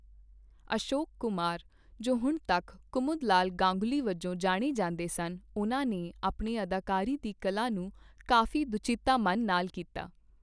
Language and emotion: Punjabi, neutral